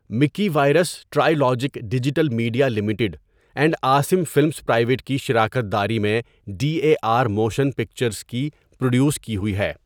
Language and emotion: Urdu, neutral